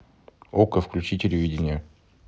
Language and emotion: Russian, neutral